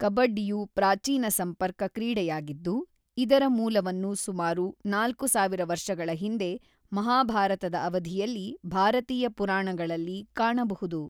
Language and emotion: Kannada, neutral